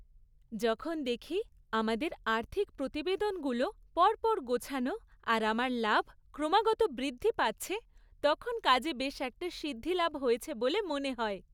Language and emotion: Bengali, happy